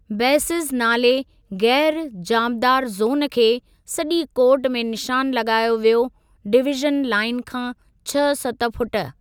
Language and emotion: Sindhi, neutral